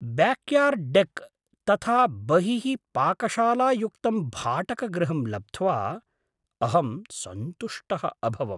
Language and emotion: Sanskrit, surprised